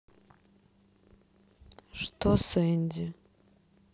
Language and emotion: Russian, sad